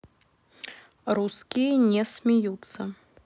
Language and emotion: Russian, neutral